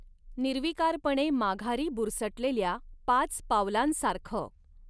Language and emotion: Marathi, neutral